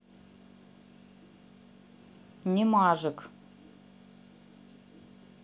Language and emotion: Russian, neutral